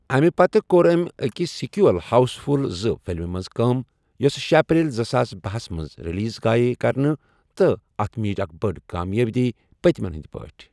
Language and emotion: Kashmiri, neutral